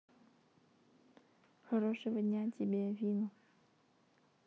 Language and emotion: Russian, neutral